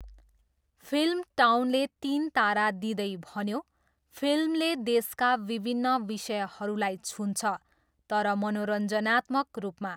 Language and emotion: Nepali, neutral